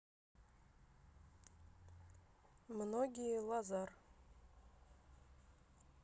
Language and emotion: Russian, neutral